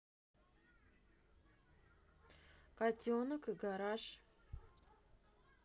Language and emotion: Russian, neutral